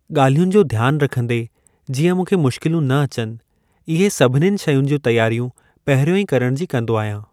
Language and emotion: Sindhi, neutral